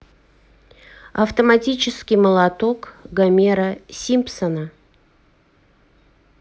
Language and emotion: Russian, neutral